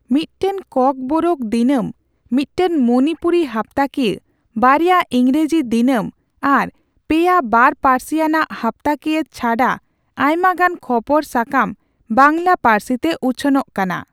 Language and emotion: Santali, neutral